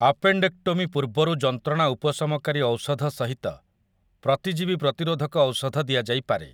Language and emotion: Odia, neutral